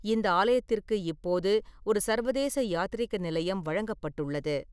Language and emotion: Tamil, neutral